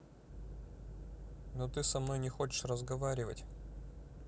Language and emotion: Russian, sad